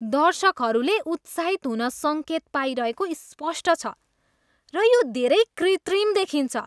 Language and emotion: Nepali, disgusted